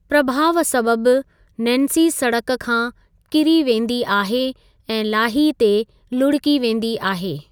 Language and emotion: Sindhi, neutral